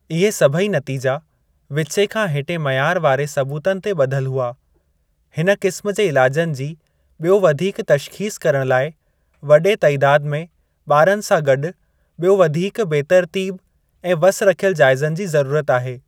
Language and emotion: Sindhi, neutral